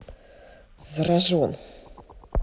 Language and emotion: Russian, neutral